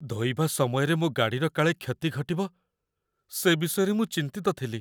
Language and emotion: Odia, fearful